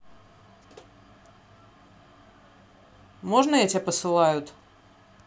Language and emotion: Russian, neutral